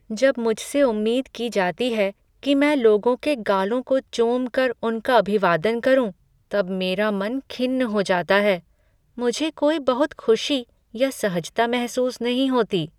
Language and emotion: Hindi, sad